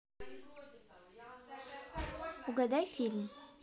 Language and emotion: Russian, positive